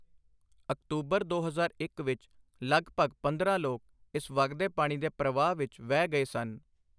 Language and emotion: Punjabi, neutral